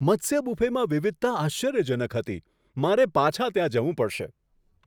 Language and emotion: Gujarati, surprised